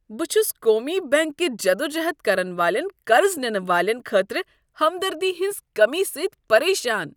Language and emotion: Kashmiri, disgusted